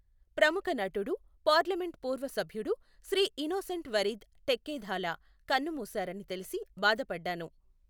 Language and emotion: Telugu, neutral